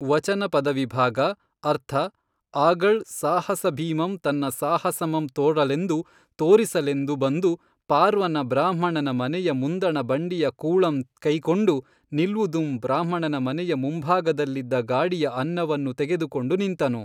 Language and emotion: Kannada, neutral